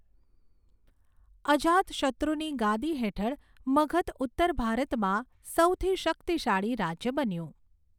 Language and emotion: Gujarati, neutral